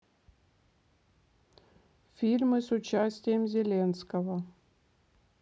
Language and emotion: Russian, neutral